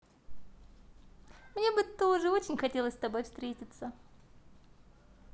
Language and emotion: Russian, positive